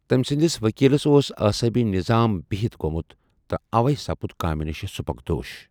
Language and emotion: Kashmiri, neutral